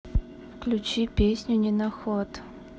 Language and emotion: Russian, neutral